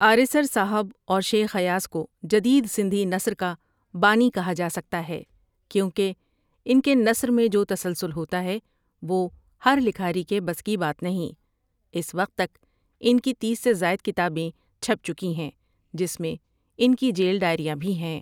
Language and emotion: Urdu, neutral